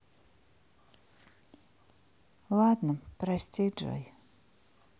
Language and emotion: Russian, sad